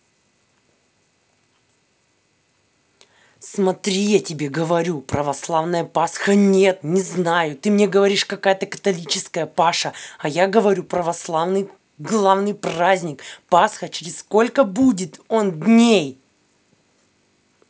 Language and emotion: Russian, angry